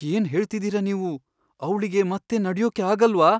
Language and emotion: Kannada, fearful